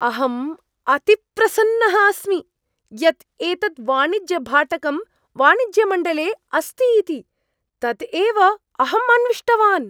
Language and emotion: Sanskrit, surprised